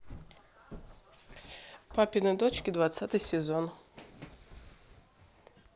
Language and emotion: Russian, neutral